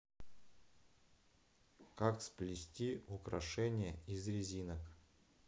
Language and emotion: Russian, neutral